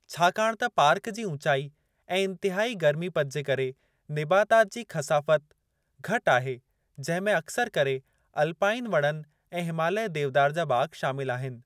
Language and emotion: Sindhi, neutral